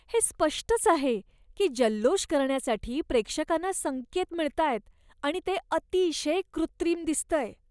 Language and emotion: Marathi, disgusted